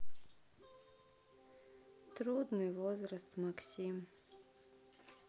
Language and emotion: Russian, sad